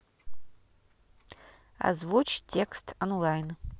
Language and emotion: Russian, neutral